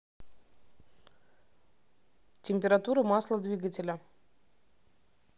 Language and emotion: Russian, neutral